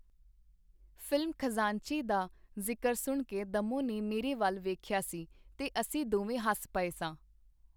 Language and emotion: Punjabi, neutral